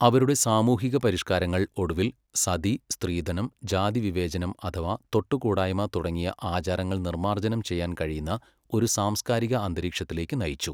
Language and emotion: Malayalam, neutral